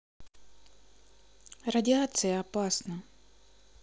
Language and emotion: Russian, neutral